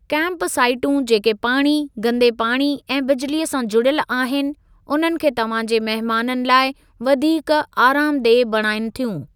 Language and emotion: Sindhi, neutral